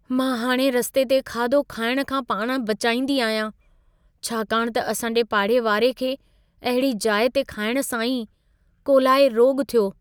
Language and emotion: Sindhi, fearful